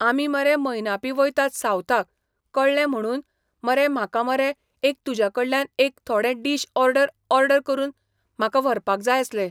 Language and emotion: Goan Konkani, neutral